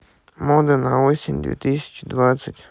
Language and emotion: Russian, neutral